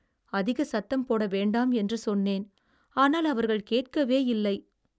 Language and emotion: Tamil, sad